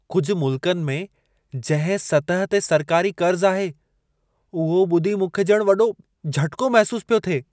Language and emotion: Sindhi, surprised